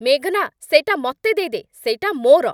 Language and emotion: Odia, angry